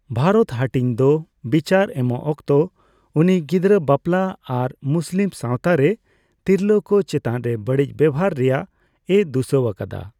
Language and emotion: Santali, neutral